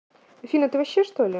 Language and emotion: Russian, neutral